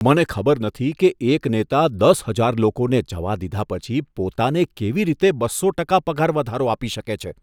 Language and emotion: Gujarati, disgusted